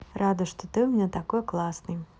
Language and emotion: Russian, positive